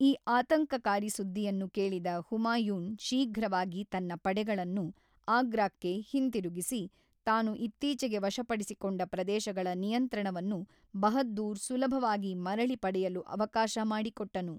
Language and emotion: Kannada, neutral